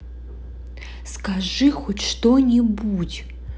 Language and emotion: Russian, angry